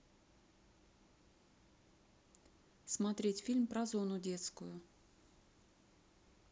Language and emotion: Russian, neutral